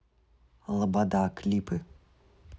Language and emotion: Russian, neutral